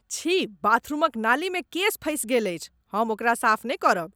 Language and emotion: Maithili, disgusted